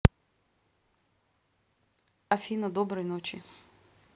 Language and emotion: Russian, neutral